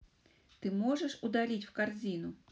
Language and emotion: Russian, neutral